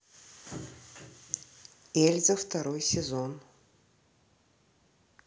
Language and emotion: Russian, neutral